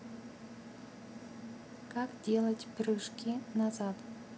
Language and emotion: Russian, neutral